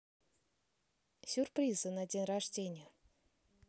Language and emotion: Russian, positive